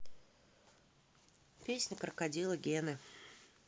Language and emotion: Russian, neutral